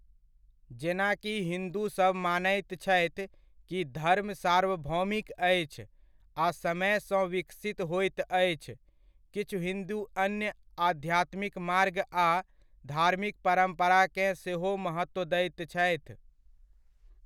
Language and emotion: Maithili, neutral